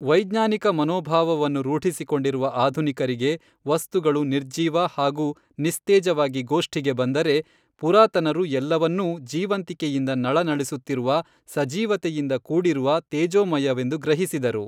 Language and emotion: Kannada, neutral